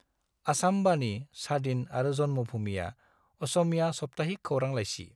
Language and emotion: Bodo, neutral